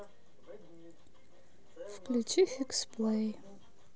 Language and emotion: Russian, sad